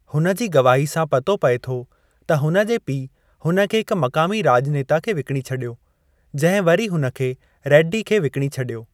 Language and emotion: Sindhi, neutral